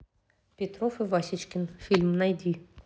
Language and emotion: Russian, neutral